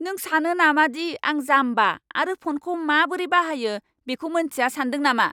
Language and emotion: Bodo, angry